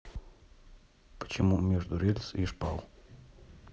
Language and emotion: Russian, neutral